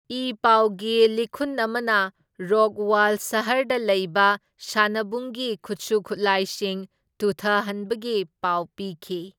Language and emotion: Manipuri, neutral